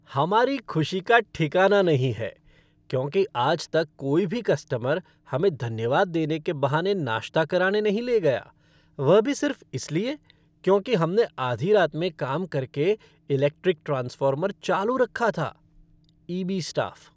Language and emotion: Hindi, happy